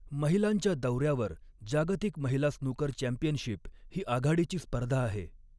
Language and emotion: Marathi, neutral